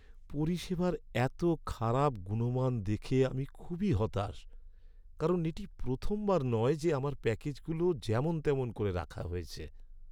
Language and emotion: Bengali, sad